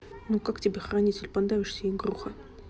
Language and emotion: Russian, angry